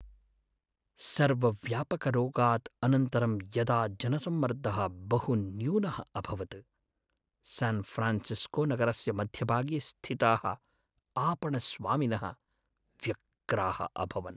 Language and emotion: Sanskrit, sad